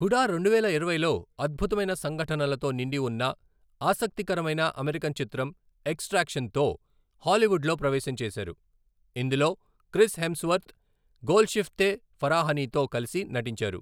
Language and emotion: Telugu, neutral